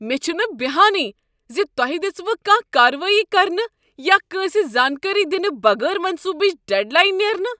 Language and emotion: Kashmiri, angry